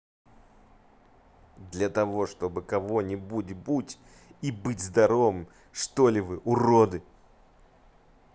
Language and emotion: Russian, angry